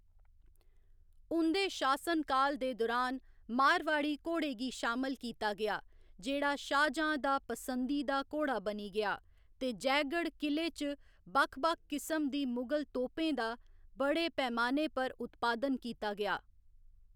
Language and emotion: Dogri, neutral